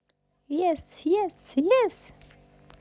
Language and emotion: Russian, positive